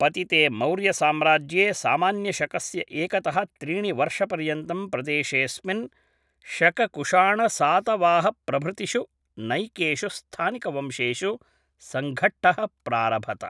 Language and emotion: Sanskrit, neutral